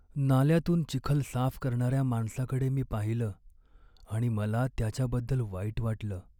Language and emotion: Marathi, sad